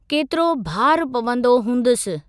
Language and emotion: Sindhi, neutral